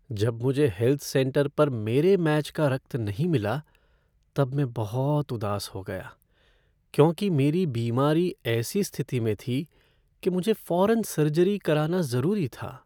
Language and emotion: Hindi, sad